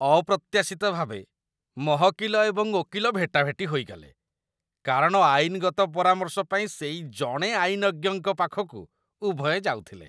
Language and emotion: Odia, disgusted